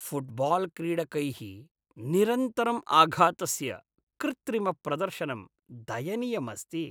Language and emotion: Sanskrit, disgusted